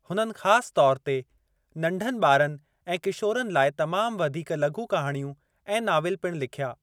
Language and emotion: Sindhi, neutral